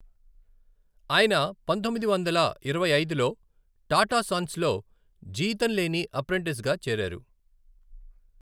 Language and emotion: Telugu, neutral